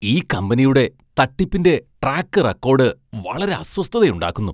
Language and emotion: Malayalam, disgusted